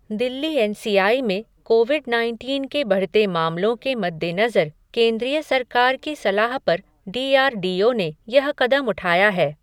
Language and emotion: Hindi, neutral